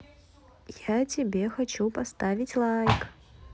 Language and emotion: Russian, positive